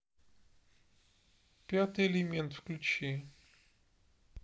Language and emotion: Russian, neutral